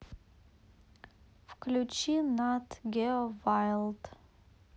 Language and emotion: Russian, neutral